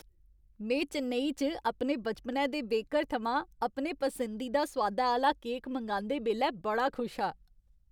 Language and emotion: Dogri, happy